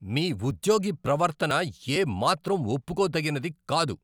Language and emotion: Telugu, angry